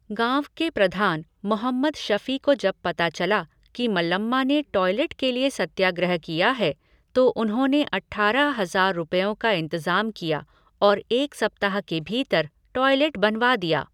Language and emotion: Hindi, neutral